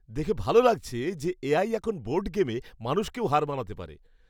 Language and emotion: Bengali, happy